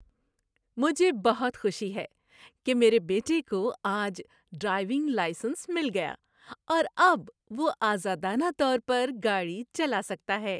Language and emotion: Urdu, happy